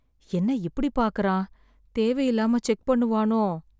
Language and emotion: Tamil, sad